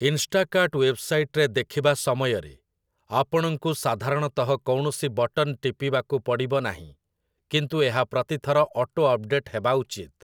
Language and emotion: Odia, neutral